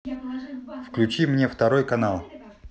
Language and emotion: Russian, neutral